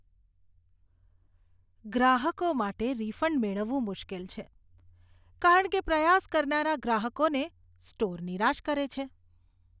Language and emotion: Gujarati, disgusted